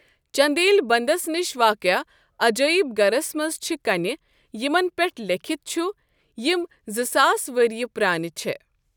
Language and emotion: Kashmiri, neutral